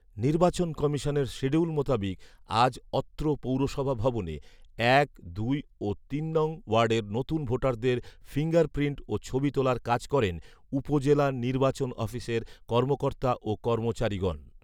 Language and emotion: Bengali, neutral